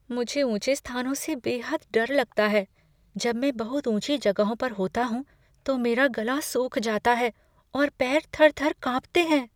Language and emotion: Hindi, fearful